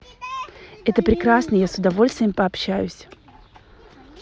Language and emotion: Russian, positive